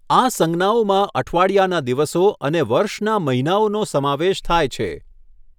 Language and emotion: Gujarati, neutral